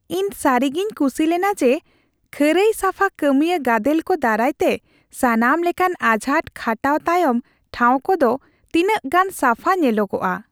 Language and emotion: Santali, happy